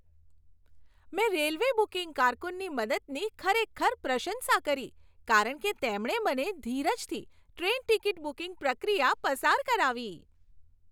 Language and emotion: Gujarati, happy